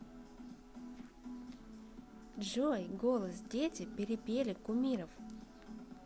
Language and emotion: Russian, positive